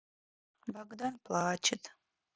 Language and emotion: Russian, sad